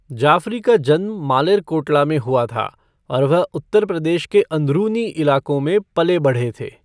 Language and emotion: Hindi, neutral